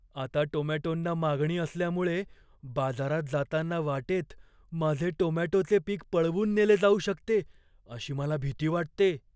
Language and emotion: Marathi, fearful